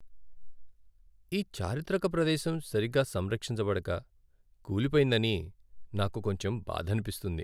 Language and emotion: Telugu, sad